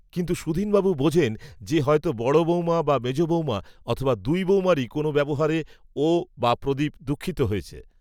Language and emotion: Bengali, neutral